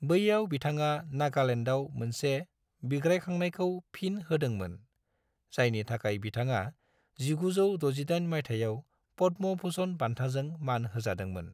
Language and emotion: Bodo, neutral